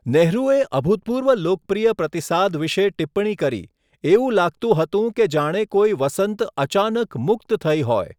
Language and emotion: Gujarati, neutral